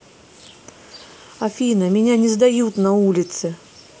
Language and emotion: Russian, neutral